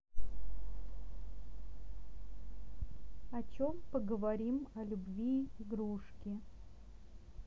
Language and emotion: Russian, neutral